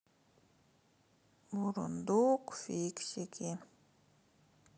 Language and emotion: Russian, sad